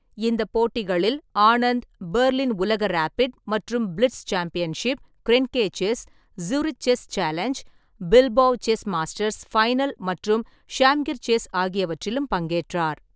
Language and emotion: Tamil, neutral